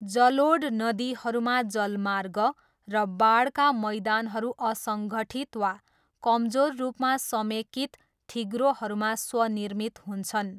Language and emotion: Nepali, neutral